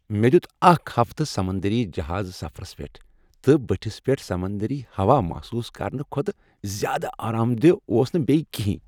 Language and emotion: Kashmiri, happy